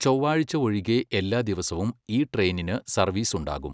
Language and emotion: Malayalam, neutral